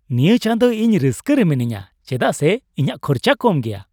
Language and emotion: Santali, happy